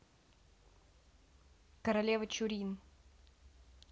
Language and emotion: Russian, neutral